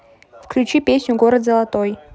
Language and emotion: Russian, neutral